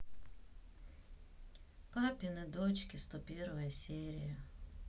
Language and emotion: Russian, sad